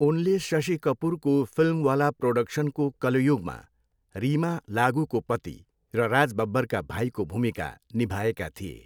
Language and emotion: Nepali, neutral